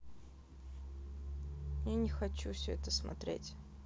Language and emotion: Russian, sad